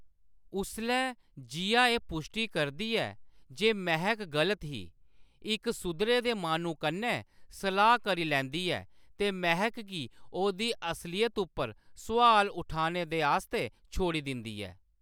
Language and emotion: Dogri, neutral